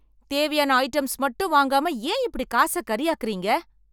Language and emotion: Tamil, angry